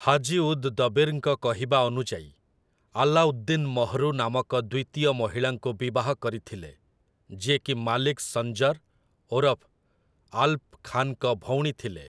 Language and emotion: Odia, neutral